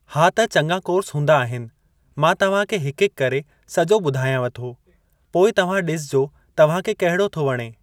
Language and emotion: Sindhi, neutral